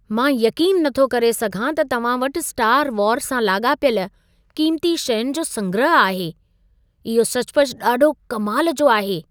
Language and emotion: Sindhi, surprised